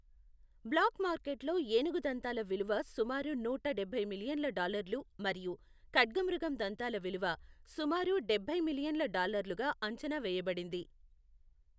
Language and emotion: Telugu, neutral